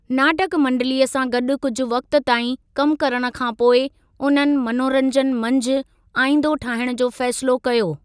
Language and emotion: Sindhi, neutral